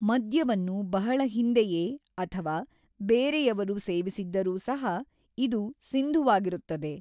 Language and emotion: Kannada, neutral